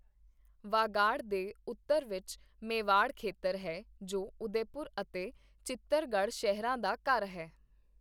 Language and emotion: Punjabi, neutral